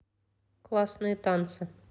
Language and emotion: Russian, neutral